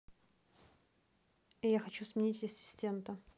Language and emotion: Russian, neutral